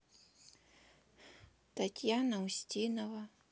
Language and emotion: Russian, neutral